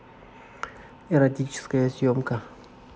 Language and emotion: Russian, neutral